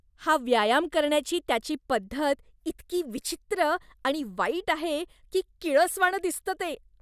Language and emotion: Marathi, disgusted